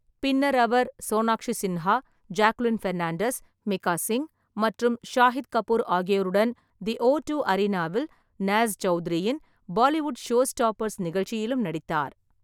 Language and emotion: Tamil, neutral